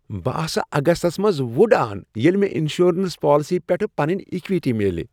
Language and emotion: Kashmiri, happy